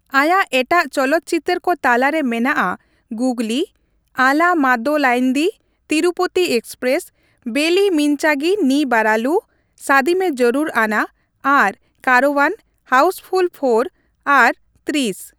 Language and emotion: Santali, neutral